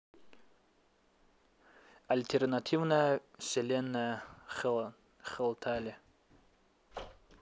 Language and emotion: Russian, neutral